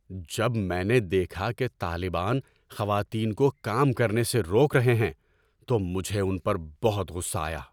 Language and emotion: Urdu, angry